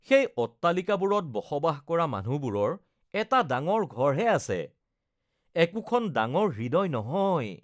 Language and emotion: Assamese, disgusted